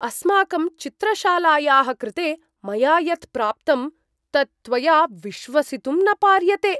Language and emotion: Sanskrit, surprised